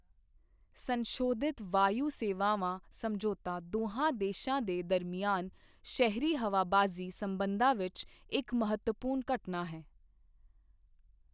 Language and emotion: Punjabi, neutral